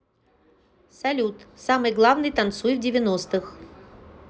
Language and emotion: Russian, neutral